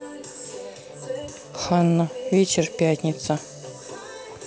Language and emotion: Russian, neutral